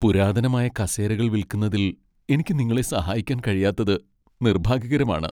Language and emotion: Malayalam, sad